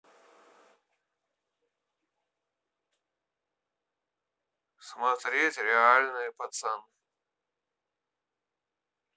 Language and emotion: Russian, neutral